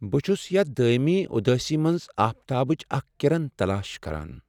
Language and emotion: Kashmiri, sad